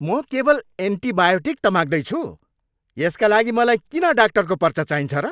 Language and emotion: Nepali, angry